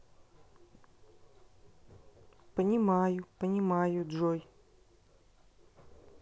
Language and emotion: Russian, neutral